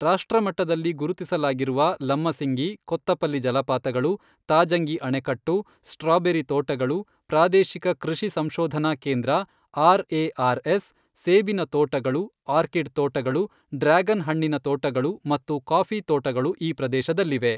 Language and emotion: Kannada, neutral